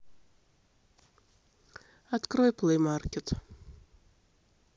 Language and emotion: Russian, sad